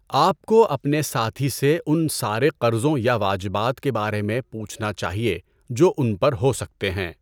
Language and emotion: Urdu, neutral